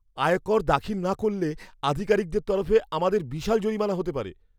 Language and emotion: Bengali, fearful